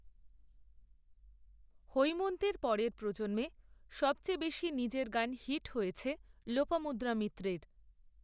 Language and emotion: Bengali, neutral